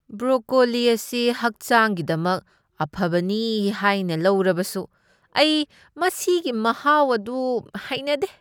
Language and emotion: Manipuri, disgusted